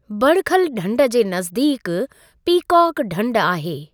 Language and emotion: Sindhi, neutral